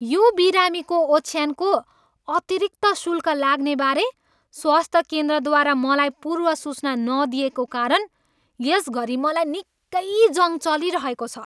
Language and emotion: Nepali, angry